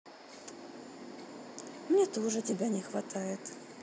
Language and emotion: Russian, sad